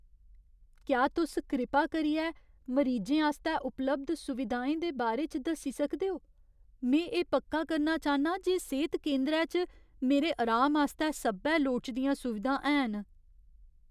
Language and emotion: Dogri, fearful